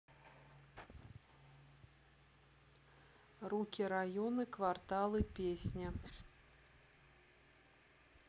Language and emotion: Russian, neutral